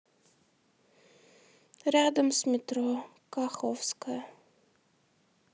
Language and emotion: Russian, sad